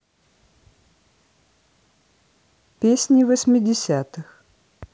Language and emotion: Russian, neutral